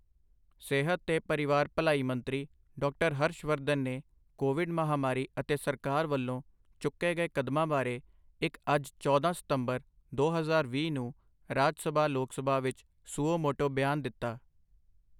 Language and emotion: Punjabi, neutral